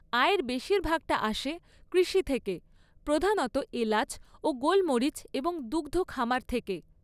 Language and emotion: Bengali, neutral